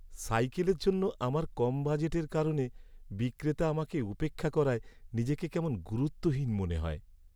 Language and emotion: Bengali, sad